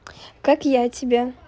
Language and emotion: Russian, positive